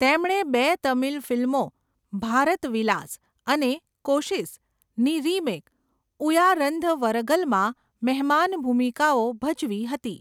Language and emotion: Gujarati, neutral